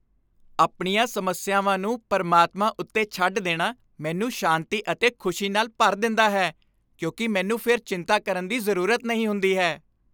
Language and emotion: Punjabi, happy